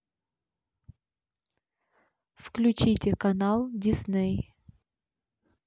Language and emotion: Russian, neutral